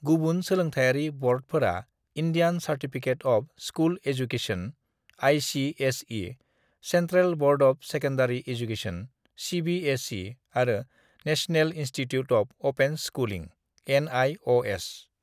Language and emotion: Bodo, neutral